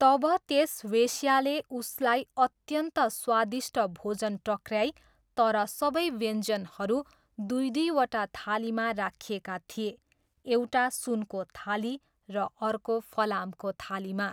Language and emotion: Nepali, neutral